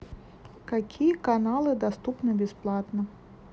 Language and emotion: Russian, neutral